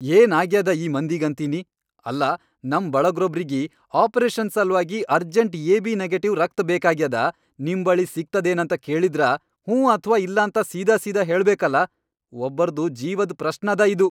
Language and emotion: Kannada, angry